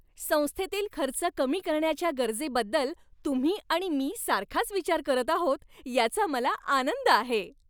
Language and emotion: Marathi, happy